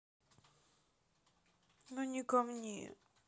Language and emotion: Russian, sad